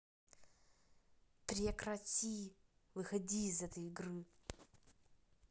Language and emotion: Russian, angry